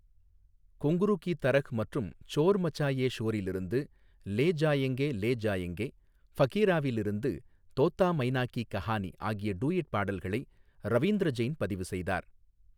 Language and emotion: Tamil, neutral